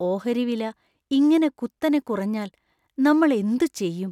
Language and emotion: Malayalam, fearful